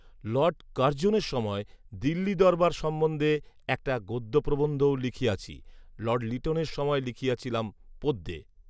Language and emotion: Bengali, neutral